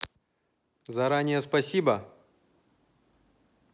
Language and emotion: Russian, neutral